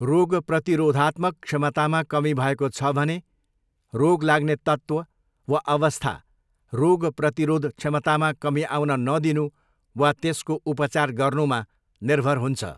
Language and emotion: Nepali, neutral